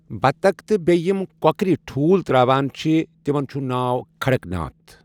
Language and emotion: Kashmiri, neutral